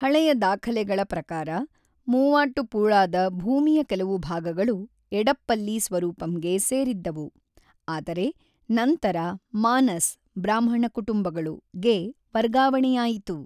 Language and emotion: Kannada, neutral